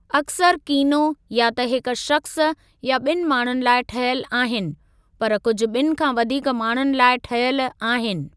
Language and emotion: Sindhi, neutral